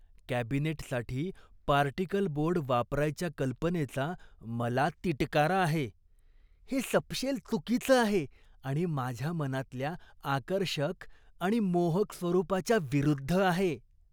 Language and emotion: Marathi, disgusted